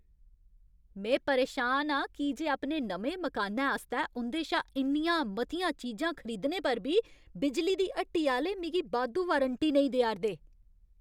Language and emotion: Dogri, angry